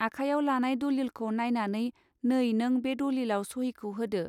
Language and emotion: Bodo, neutral